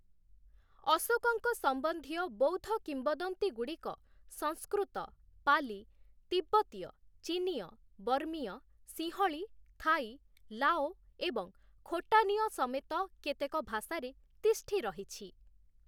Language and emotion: Odia, neutral